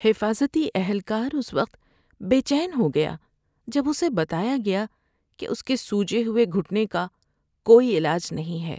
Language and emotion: Urdu, sad